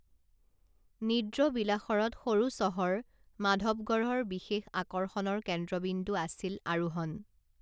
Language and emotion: Assamese, neutral